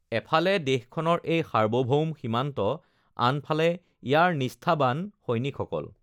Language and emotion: Assamese, neutral